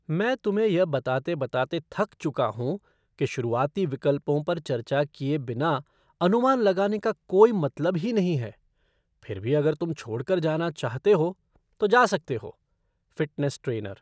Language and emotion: Hindi, disgusted